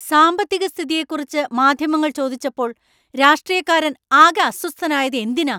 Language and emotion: Malayalam, angry